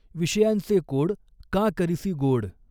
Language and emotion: Marathi, neutral